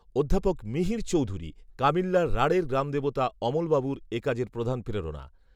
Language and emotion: Bengali, neutral